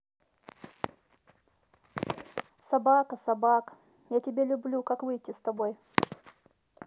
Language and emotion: Russian, sad